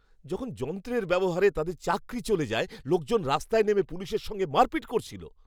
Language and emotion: Bengali, angry